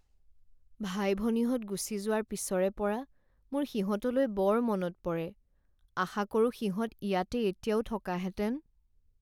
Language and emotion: Assamese, sad